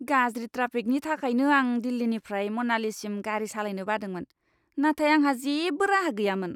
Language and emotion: Bodo, disgusted